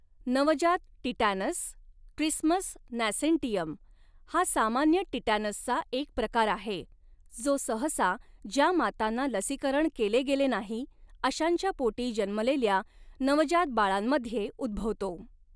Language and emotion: Marathi, neutral